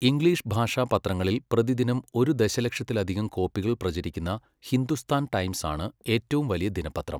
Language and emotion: Malayalam, neutral